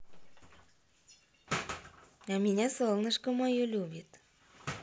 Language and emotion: Russian, positive